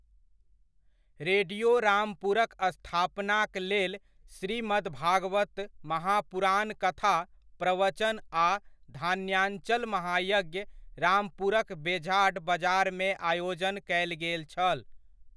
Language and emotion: Maithili, neutral